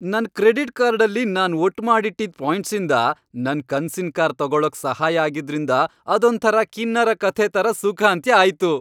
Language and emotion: Kannada, happy